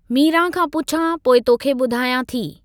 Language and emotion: Sindhi, neutral